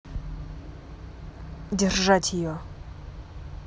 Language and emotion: Russian, angry